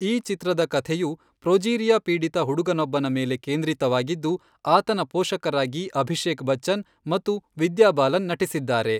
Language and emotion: Kannada, neutral